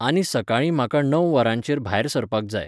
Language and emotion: Goan Konkani, neutral